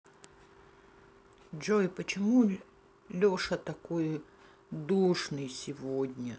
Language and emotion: Russian, sad